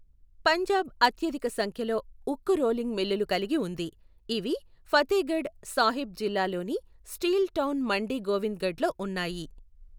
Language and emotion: Telugu, neutral